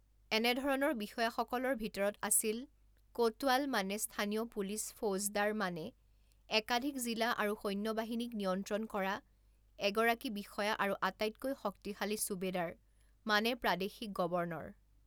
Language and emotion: Assamese, neutral